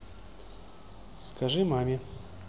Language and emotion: Russian, neutral